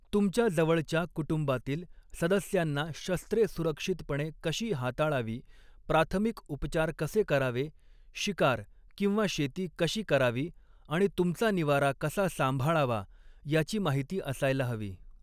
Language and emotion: Marathi, neutral